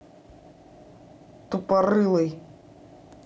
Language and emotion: Russian, angry